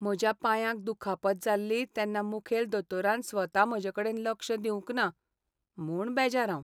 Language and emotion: Goan Konkani, sad